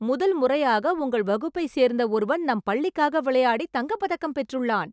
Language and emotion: Tamil, surprised